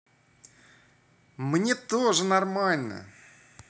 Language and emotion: Russian, positive